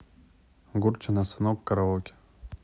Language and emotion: Russian, neutral